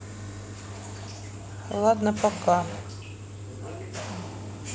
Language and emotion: Russian, sad